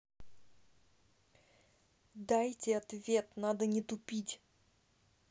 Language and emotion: Russian, angry